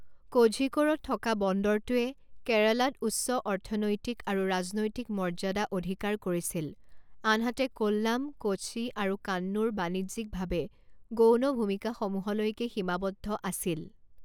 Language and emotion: Assamese, neutral